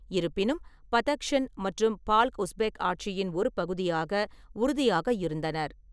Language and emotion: Tamil, neutral